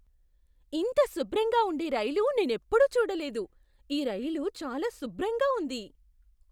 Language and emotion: Telugu, surprised